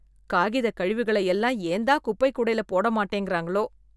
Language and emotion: Tamil, disgusted